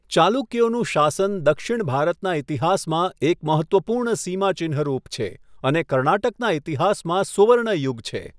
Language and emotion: Gujarati, neutral